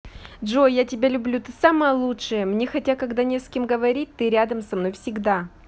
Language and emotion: Russian, positive